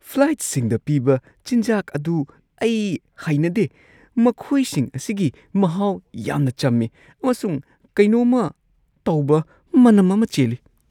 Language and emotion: Manipuri, disgusted